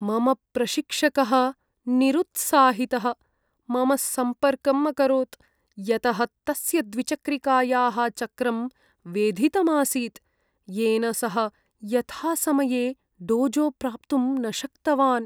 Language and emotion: Sanskrit, sad